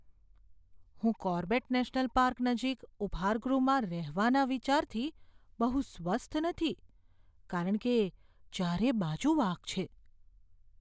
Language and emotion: Gujarati, fearful